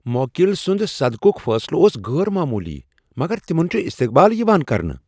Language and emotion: Kashmiri, surprised